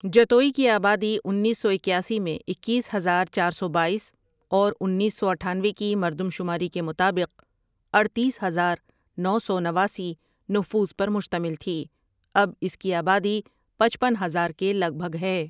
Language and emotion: Urdu, neutral